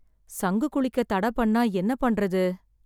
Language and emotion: Tamil, sad